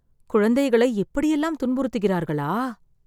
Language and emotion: Tamil, sad